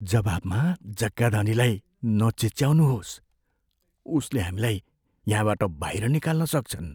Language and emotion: Nepali, fearful